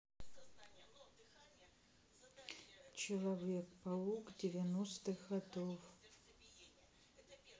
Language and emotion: Russian, neutral